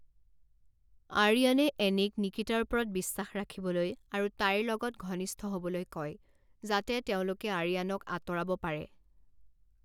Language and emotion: Assamese, neutral